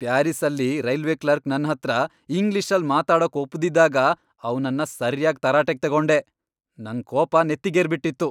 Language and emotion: Kannada, angry